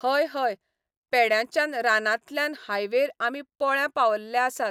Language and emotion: Goan Konkani, neutral